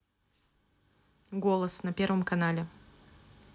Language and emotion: Russian, neutral